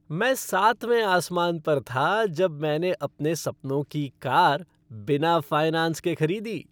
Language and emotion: Hindi, happy